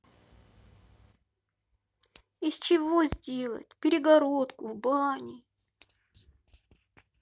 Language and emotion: Russian, sad